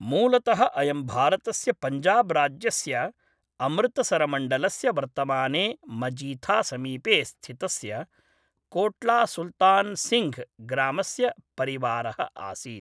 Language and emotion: Sanskrit, neutral